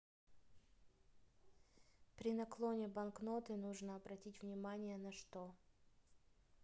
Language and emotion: Russian, neutral